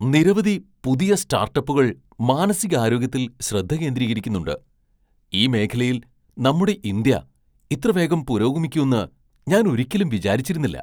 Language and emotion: Malayalam, surprised